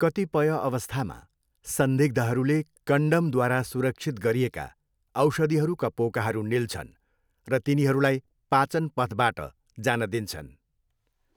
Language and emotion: Nepali, neutral